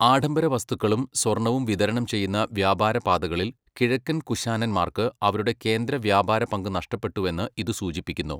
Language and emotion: Malayalam, neutral